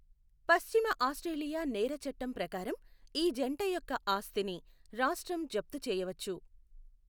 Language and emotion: Telugu, neutral